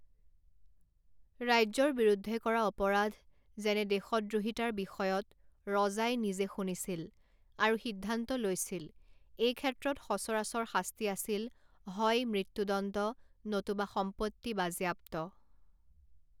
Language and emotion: Assamese, neutral